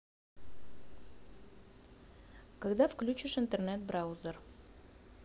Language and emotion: Russian, neutral